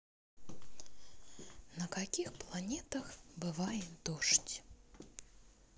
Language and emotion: Russian, neutral